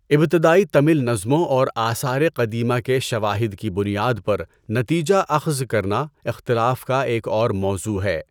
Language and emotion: Urdu, neutral